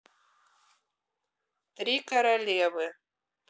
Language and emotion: Russian, neutral